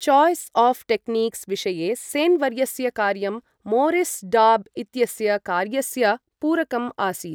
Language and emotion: Sanskrit, neutral